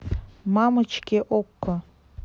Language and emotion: Russian, neutral